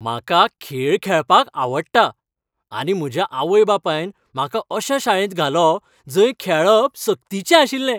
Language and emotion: Goan Konkani, happy